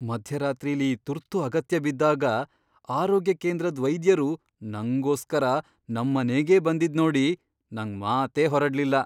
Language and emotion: Kannada, surprised